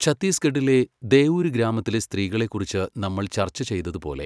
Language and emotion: Malayalam, neutral